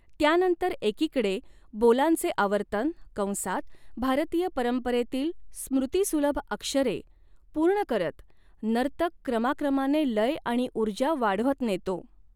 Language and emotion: Marathi, neutral